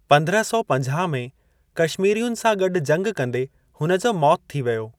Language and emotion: Sindhi, neutral